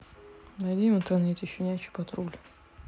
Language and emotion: Russian, neutral